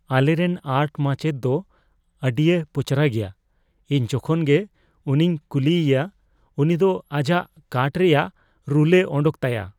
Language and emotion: Santali, fearful